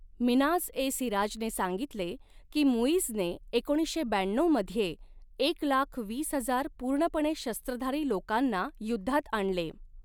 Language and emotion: Marathi, neutral